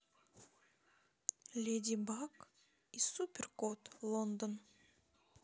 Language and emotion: Russian, neutral